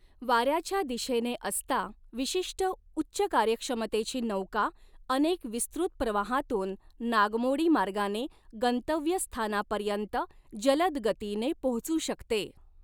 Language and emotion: Marathi, neutral